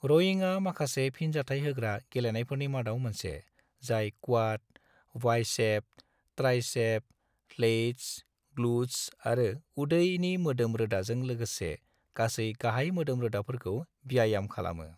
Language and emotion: Bodo, neutral